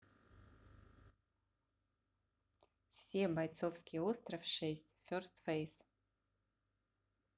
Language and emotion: Russian, neutral